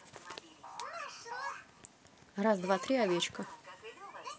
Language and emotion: Russian, neutral